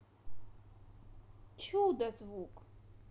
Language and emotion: Russian, positive